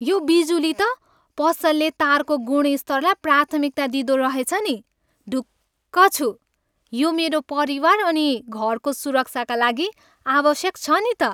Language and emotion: Nepali, happy